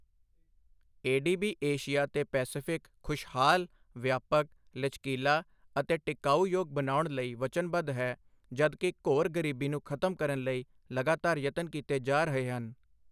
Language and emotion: Punjabi, neutral